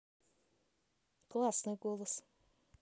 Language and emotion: Russian, neutral